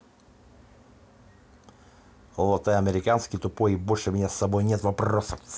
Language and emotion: Russian, angry